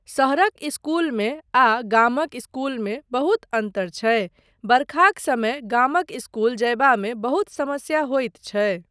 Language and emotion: Maithili, neutral